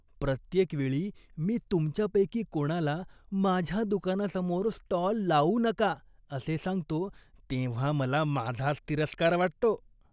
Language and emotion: Marathi, disgusted